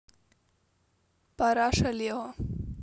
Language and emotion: Russian, neutral